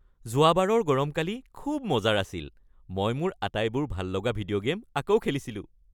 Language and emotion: Assamese, happy